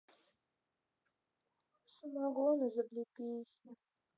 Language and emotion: Russian, sad